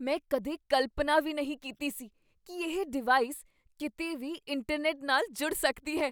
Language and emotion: Punjabi, surprised